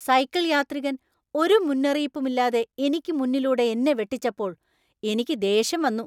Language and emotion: Malayalam, angry